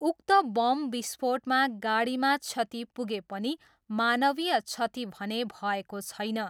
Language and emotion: Nepali, neutral